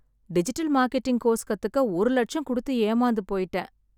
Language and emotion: Tamil, sad